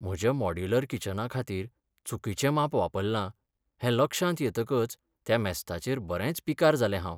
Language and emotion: Goan Konkani, sad